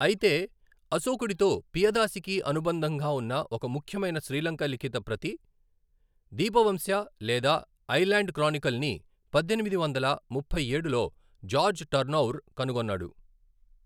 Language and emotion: Telugu, neutral